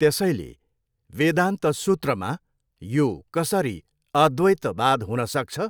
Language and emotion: Nepali, neutral